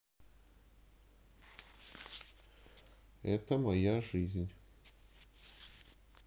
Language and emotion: Russian, neutral